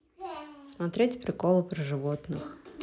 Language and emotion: Russian, neutral